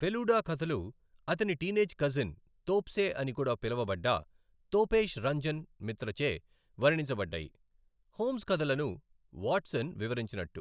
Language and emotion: Telugu, neutral